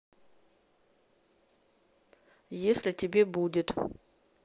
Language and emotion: Russian, neutral